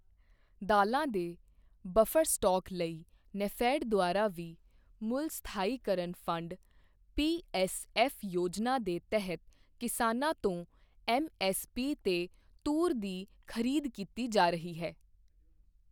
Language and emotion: Punjabi, neutral